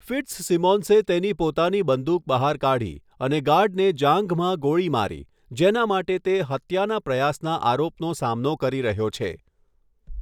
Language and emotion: Gujarati, neutral